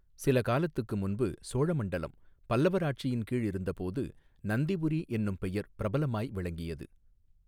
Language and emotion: Tamil, neutral